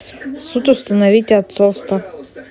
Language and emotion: Russian, neutral